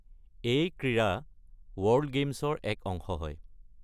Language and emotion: Assamese, neutral